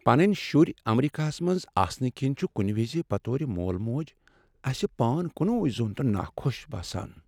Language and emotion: Kashmiri, sad